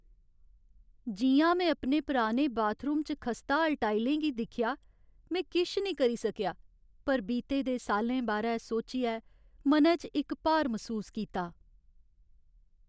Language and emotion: Dogri, sad